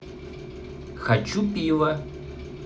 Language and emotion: Russian, neutral